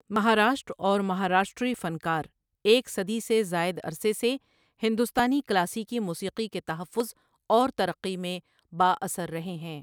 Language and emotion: Urdu, neutral